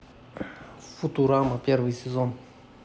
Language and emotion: Russian, neutral